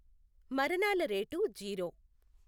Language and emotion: Telugu, neutral